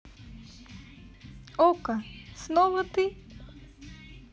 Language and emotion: Russian, positive